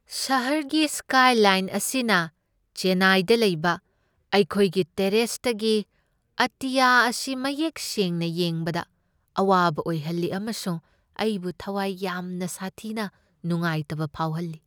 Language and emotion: Manipuri, sad